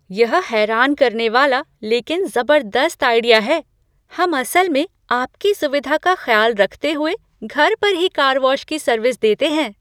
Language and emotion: Hindi, surprised